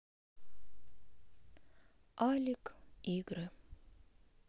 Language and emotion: Russian, sad